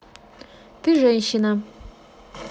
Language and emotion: Russian, neutral